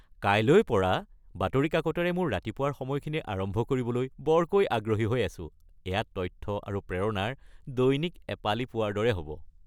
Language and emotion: Assamese, happy